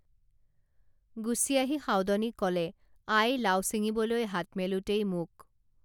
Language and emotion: Assamese, neutral